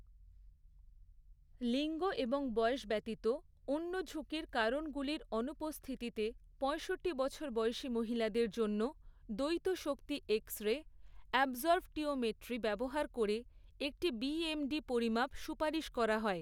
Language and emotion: Bengali, neutral